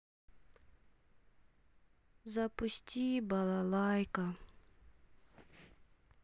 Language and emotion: Russian, sad